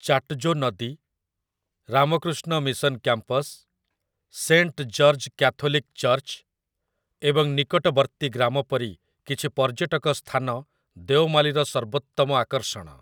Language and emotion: Odia, neutral